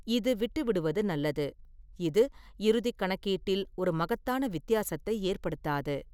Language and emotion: Tamil, neutral